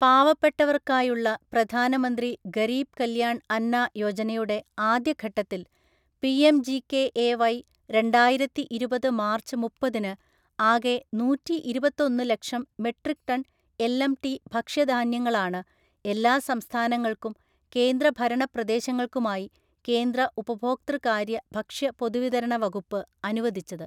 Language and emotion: Malayalam, neutral